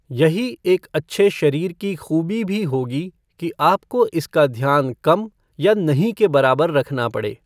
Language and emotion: Hindi, neutral